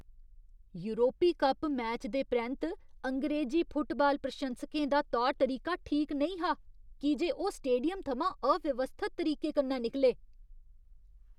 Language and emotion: Dogri, disgusted